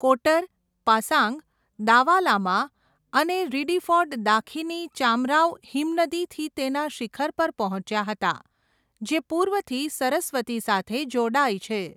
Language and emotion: Gujarati, neutral